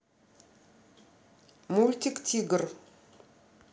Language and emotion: Russian, neutral